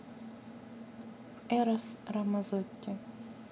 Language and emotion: Russian, neutral